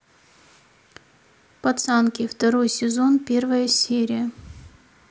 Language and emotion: Russian, neutral